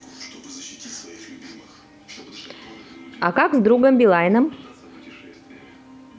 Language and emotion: Russian, positive